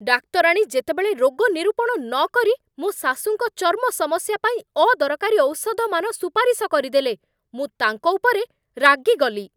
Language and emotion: Odia, angry